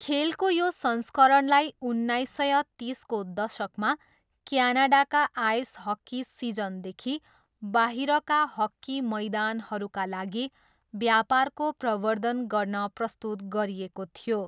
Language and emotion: Nepali, neutral